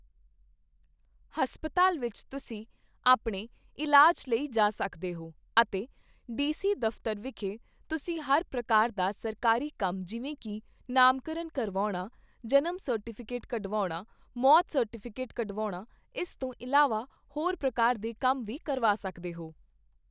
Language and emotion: Punjabi, neutral